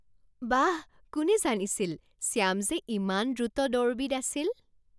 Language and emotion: Assamese, surprised